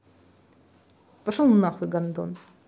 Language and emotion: Russian, angry